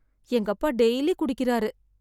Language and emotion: Tamil, sad